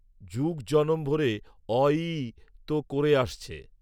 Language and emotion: Bengali, neutral